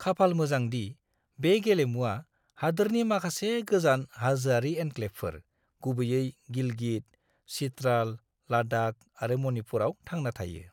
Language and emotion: Bodo, neutral